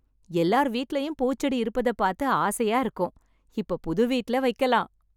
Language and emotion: Tamil, happy